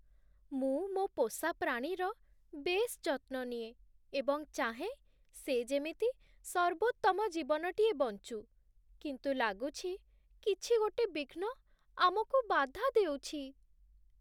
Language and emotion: Odia, sad